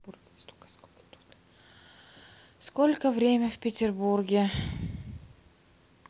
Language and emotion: Russian, sad